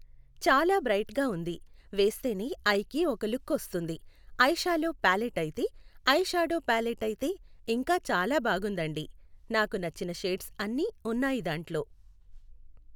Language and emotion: Telugu, neutral